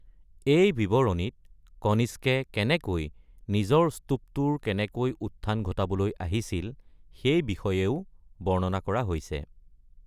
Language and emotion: Assamese, neutral